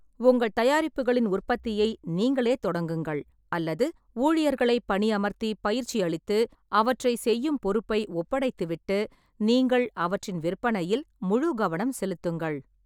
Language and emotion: Tamil, neutral